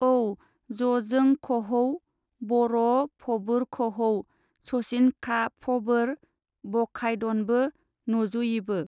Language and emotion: Bodo, neutral